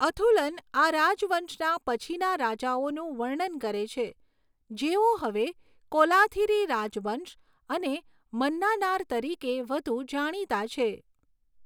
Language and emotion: Gujarati, neutral